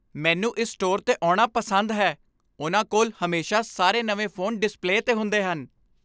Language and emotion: Punjabi, happy